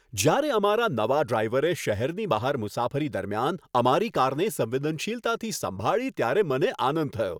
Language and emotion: Gujarati, happy